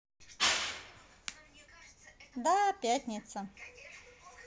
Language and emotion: Russian, positive